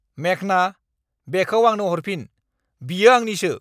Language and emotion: Bodo, angry